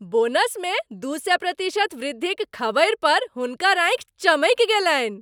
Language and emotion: Maithili, happy